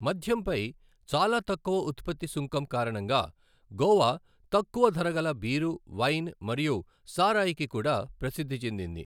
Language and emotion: Telugu, neutral